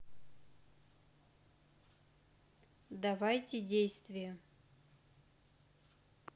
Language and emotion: Russian, neutral